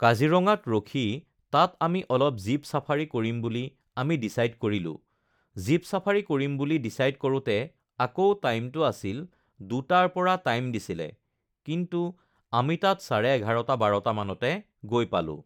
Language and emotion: Assamese, neutral